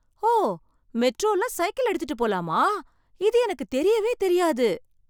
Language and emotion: Tamil, surprised